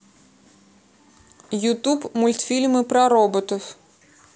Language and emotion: Russian, neutral